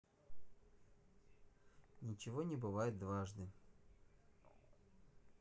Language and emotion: Russian, neutral